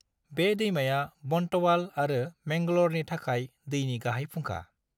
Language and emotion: Bodo, neutral